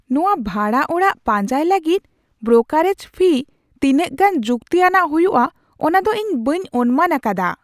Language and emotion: Santali, surprised